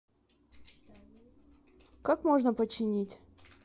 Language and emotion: Russian, neutral